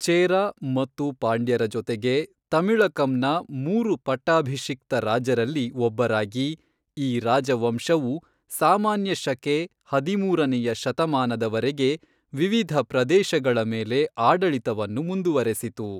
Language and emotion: Kannada, neutral